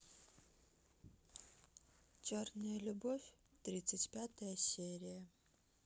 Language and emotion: Russian, sad